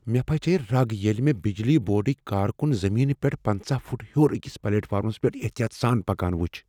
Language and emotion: Kashmiri, fearful